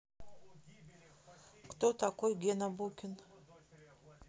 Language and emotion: Russian, neutral